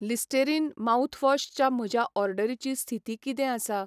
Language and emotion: Goan Konkani, neutral